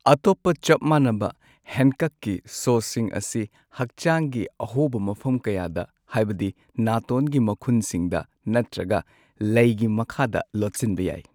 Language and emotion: Manipuri, neutral